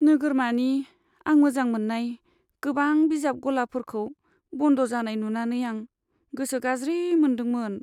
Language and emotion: Bodo, sad